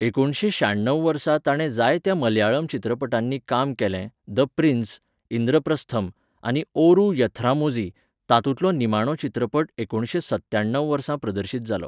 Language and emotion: Goan Konkani, neutral